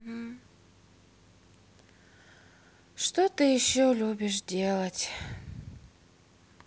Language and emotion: Russian, sad